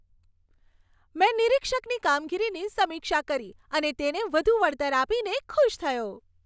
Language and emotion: Gujarati, happy